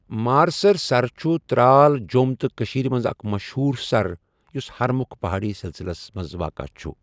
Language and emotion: Kashmiri, neutral